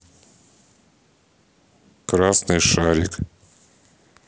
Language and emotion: Russian, neutral